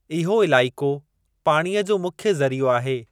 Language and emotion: Sindhi, neutral